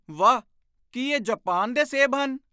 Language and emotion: Punjabi, surprised